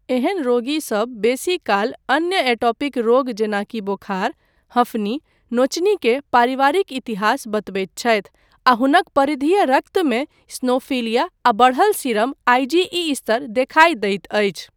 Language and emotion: Maithili, neutral